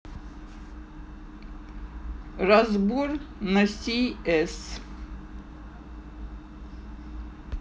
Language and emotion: Russian, neutral